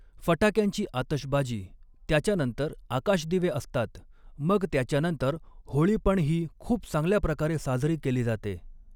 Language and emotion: Marathi, neutral